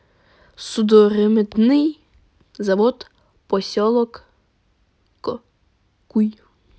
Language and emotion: Russian, neutral